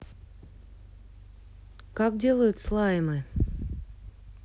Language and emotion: Russian, neutral